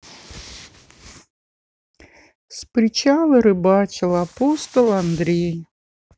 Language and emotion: Russian, sad